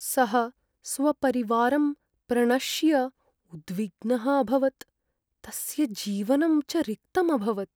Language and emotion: Sanskrit, sad